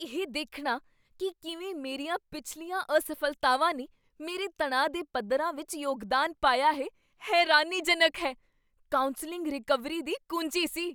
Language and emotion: Punjabi, surprised